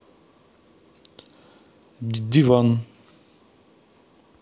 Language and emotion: Russian, neutral